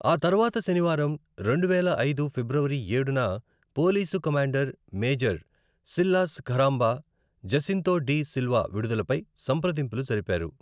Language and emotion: Telugu, neutral